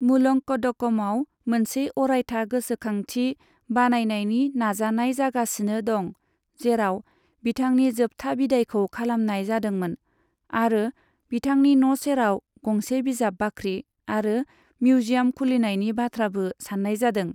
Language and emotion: Bodo, neutral